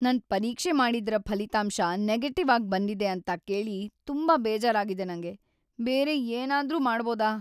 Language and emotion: Kannada, sad